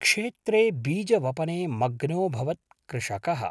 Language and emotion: Sanskrit, neutral